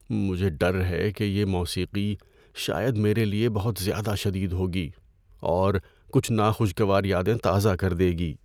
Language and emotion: Urdu, fearful